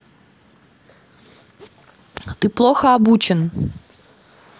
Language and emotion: Russian, angry